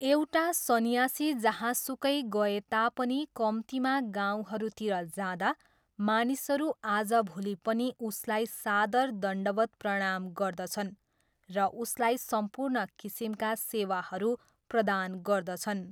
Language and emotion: Nepali, neutral